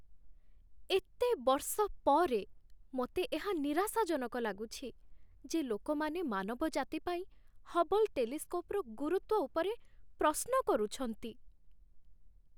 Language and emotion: Odia, sad